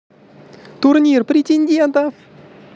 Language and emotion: Russian, positive